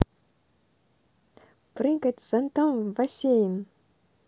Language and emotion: Russian, positive